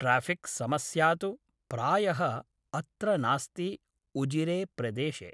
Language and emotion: Sanskrit, neutral